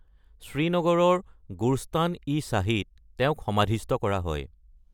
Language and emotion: Assamese, neutral